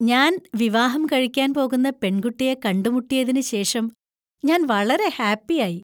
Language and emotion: Malayalam, happy